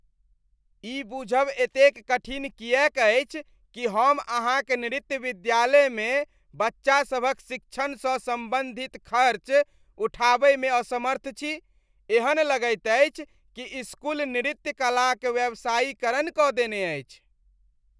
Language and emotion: Maithili, disgusted